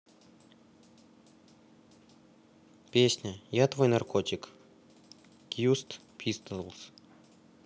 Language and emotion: Russian, neutral